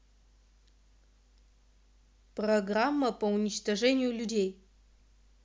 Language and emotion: Russian, neutral